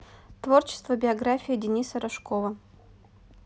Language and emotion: Russian, neutral